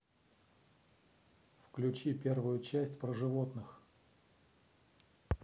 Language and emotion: Russian, neutral